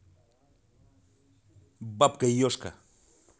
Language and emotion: Russian, angry